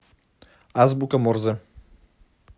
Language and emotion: Russian, neutral